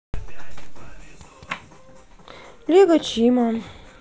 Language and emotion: Russian, sad